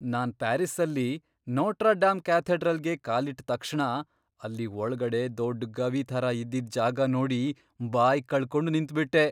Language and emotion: Kannada, surprised